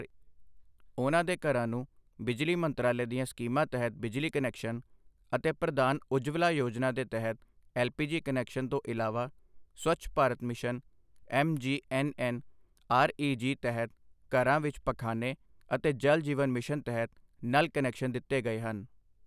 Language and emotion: Punjabi, neutral